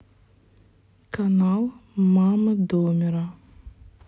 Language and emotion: Russian, neutral